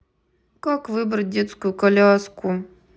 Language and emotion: Russian, sad